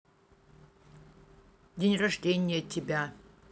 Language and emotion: Russian, positive